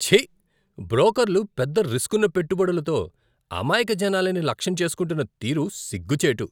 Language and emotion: Telugu, disgusted